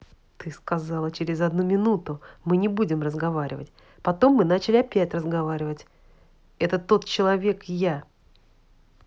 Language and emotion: Russian, angry